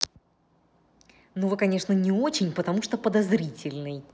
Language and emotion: Russian, angry